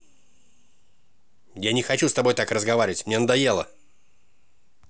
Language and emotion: Russian, angry